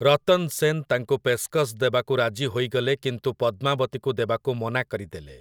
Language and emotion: Odia, neutral